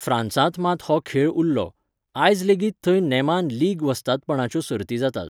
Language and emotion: Goan Konkani, neutral